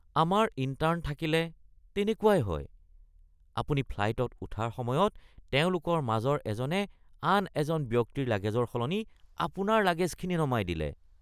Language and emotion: Assamese, disgusted